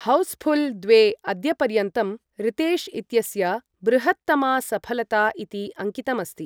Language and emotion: Sanskrit, neutral